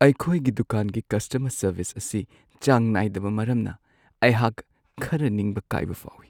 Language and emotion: Manipuri, sad